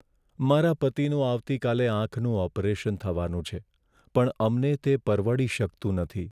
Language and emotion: Gujarati, sad